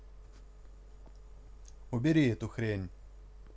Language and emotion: Russian, angry